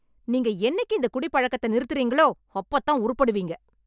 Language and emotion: Tamil, angry